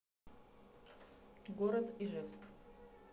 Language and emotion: Russian, neutral